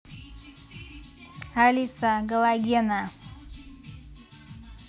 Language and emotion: Russian, neutral